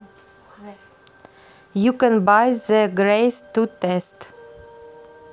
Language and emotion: Russian, neutral